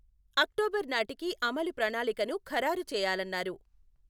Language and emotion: Telugu, neutral